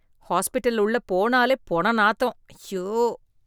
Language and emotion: Tamil, disgusted